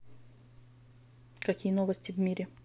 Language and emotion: Russian, neutral